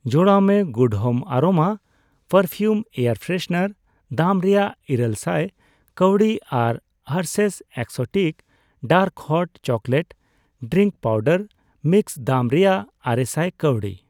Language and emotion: Santali, neutral